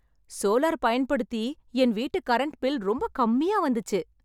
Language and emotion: Tamil, happy